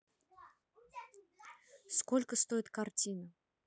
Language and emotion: Russian, neutral